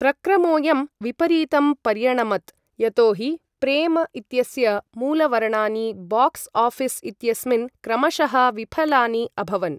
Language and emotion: Sanskrit, neutral